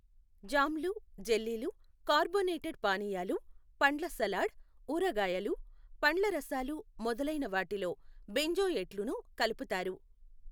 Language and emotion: Telugu, neutral